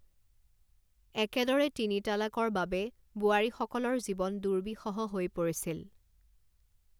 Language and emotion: Assamese, neutral